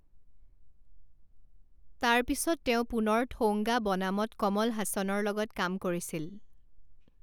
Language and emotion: Assamese, neutral